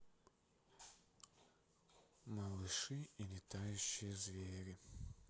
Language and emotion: Russian, sad